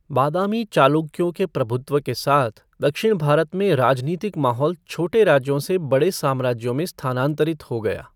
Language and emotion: Hindi, neutral